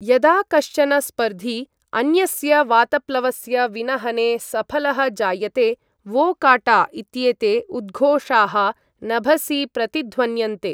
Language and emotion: Sanskrit, neutral